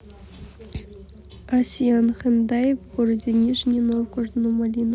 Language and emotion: Russian, neutral